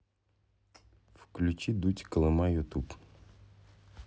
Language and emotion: Russian, neutral